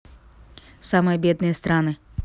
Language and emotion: Russian, neutral